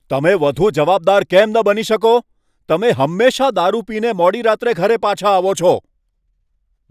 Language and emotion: Gujarati, angry